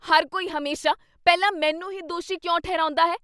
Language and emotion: Punjabi, angry